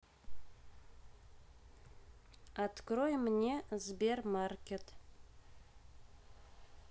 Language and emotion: Russian, neutral